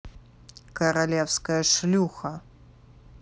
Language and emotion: Russian, angry